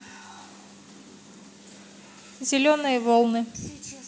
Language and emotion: Russian, neutral